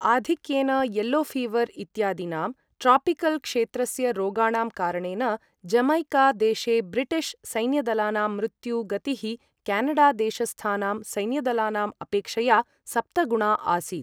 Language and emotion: Sanskrit, neutral